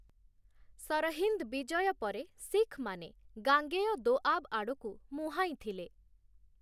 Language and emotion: Odia, neutral